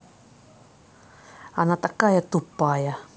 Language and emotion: Russian, angry